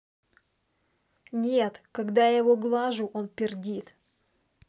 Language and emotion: Russian, angry